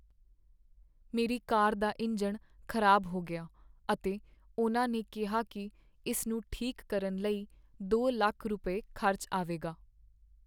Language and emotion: Punjabi, sad